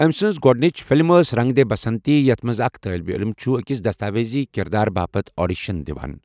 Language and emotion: Kashmiri, neutral